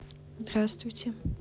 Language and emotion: Russian, neutral